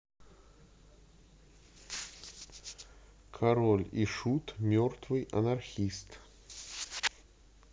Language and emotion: Russian, neutral